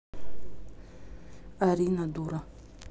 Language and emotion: Russian, neutral